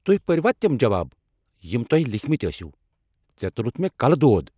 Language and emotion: Kashmiri, angry